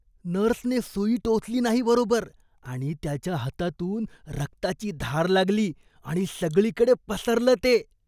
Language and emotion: Marathi, disgusted